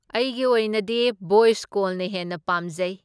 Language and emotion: Manipuri, neutral